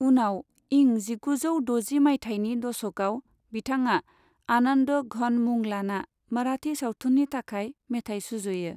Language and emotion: Bodo, neutral